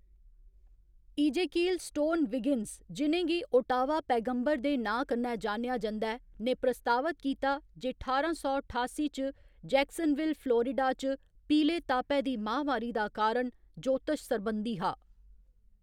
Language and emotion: Dogri, neutral